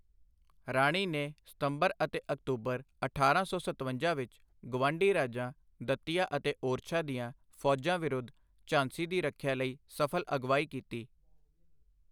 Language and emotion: Punjabi, neutral